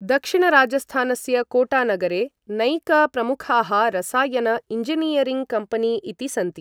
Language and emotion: Sanskrit, neutral